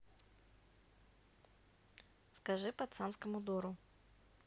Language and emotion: Russian, neutral